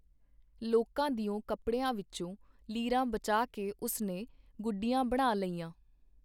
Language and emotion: Punjabi, neutral